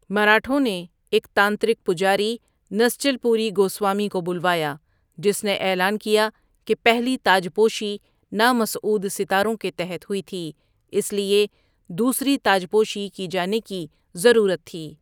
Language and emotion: Urdu, neutral